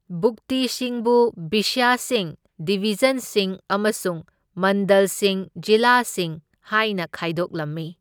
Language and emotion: Manipuri, neutral